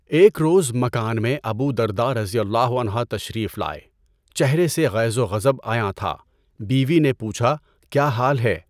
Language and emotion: Urdu, neutral